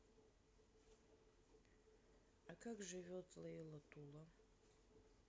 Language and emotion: Russian, sad